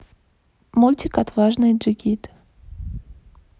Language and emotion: Russian, neutral